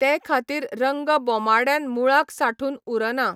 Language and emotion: Goan Konkani, neutral